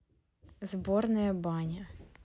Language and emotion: Russian, neutral